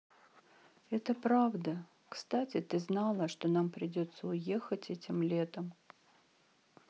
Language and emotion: Russian, sad